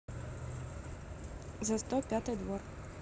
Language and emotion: Russian, neutral